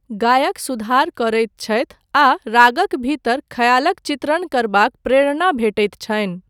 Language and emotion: Maithili, neutral